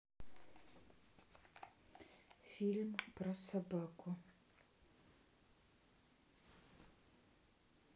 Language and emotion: Russian, neutral